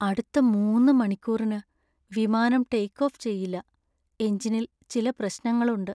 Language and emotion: Malayalam, sad